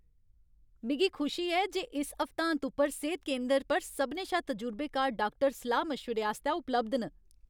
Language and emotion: Dogri, happy